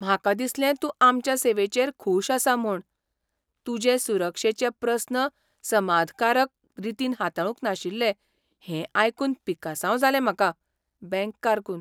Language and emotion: Goan Konkani, surprised